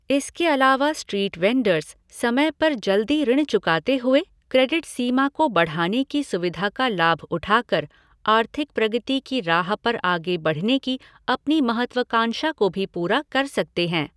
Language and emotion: Hindi, neutral